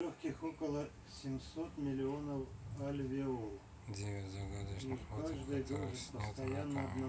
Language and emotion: Russian, neutral